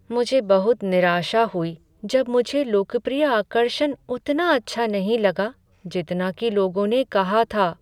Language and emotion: Hindi, sad